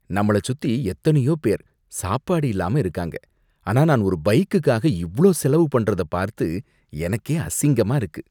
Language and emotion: Tamil, disgusted